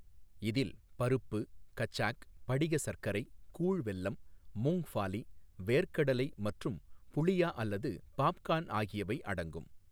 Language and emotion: Tamil, neutral